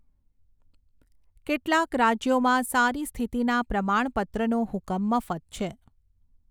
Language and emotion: Gujarati, neutral